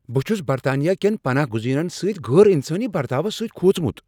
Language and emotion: Kashmiri, angry